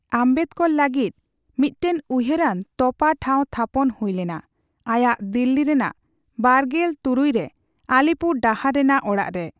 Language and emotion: Santali, neutral